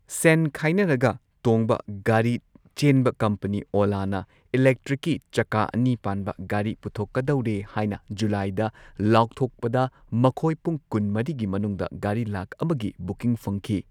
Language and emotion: Manipuri, neutral